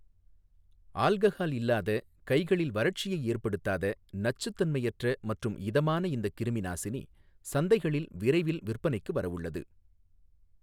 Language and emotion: Tamil, neutral